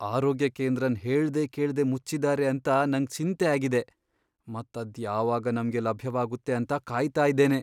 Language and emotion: Kannada, fearful